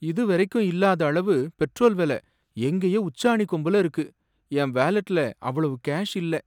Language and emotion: Tamil, sad